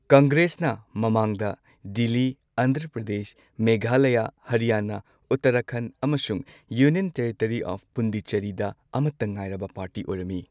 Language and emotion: Manipuri, neutral